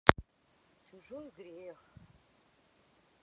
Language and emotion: Russian, neutral